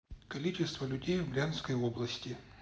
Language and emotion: Russian, neutral